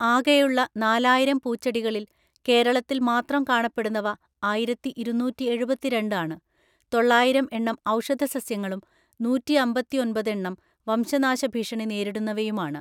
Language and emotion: Malayalam, neutral